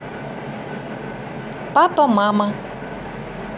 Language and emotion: Russian, neutral